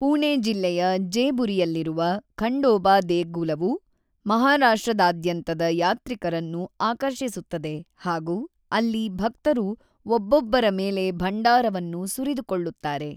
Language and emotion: Kannada, neutral